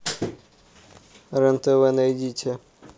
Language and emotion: Russian, neutral